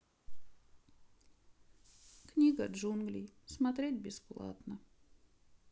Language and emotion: Russian, sad